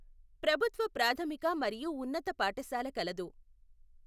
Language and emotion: Telugu, neutral